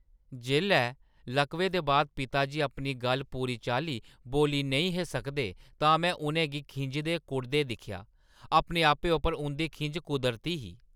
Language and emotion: Dogri, angry